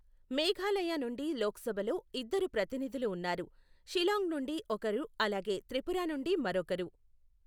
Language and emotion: Telugu, neutral